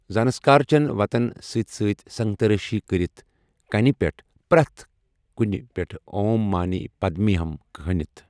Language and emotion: Kashmiri, neutral